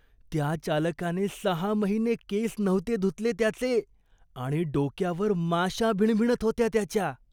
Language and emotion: Marathi, disgusted